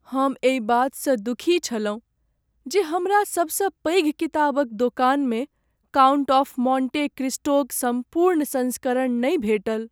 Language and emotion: Maithili, sad